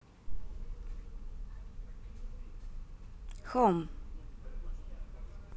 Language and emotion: Russian, neutral